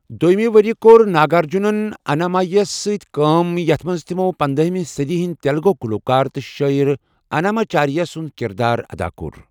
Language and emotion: Kashmiri, neutral